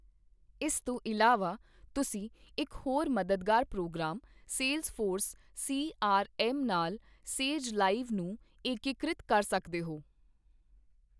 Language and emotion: Punjabi, neutral